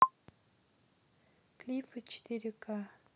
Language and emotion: Russian, neutral